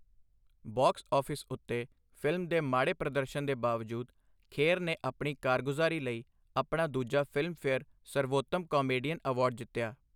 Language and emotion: Punjabi, neutral